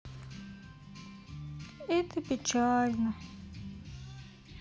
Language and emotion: Russian, sad